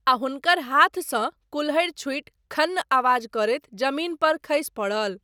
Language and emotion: Maithili, neutral